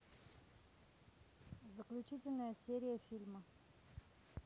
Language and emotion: Russian, neutral